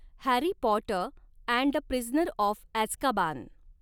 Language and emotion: Marathi, neutral